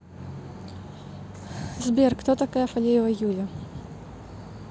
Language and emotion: Russian, neutral